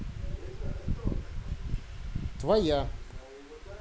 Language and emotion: Russian, neutral